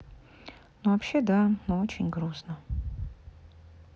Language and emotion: Russian, sad